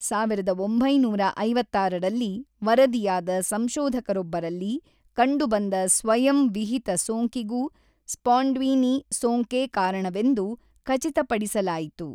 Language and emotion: Kannada, neutral